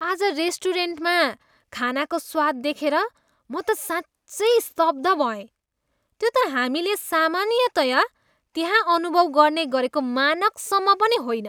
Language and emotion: Nepali, disgusted